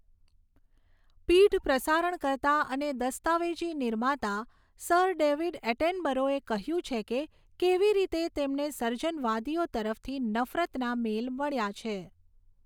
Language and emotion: Gujarati, neutral